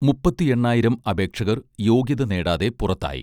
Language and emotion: Malayalam, neutral